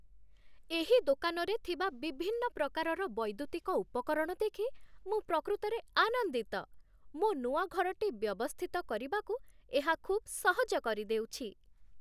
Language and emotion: Odia, happy